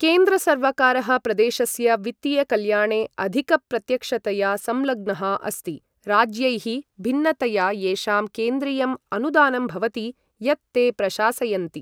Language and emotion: Sanskrit, neutral